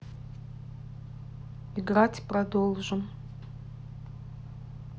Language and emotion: Russian, neutral